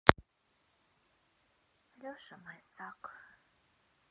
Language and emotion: Russian, sad